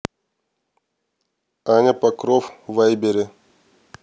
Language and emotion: Russian, neutral